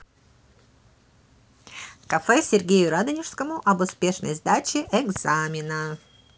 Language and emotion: Russian, positive